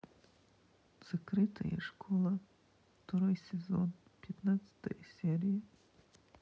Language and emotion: Russian, sad